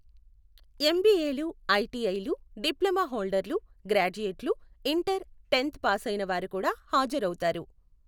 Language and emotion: Telugu, neutral